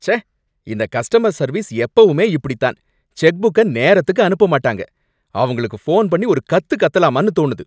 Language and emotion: Tamil, angry